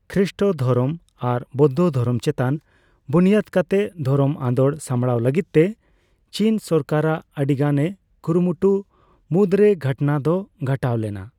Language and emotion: Santali, neutral